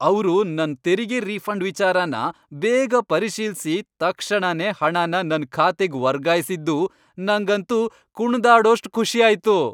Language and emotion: Kannada, happy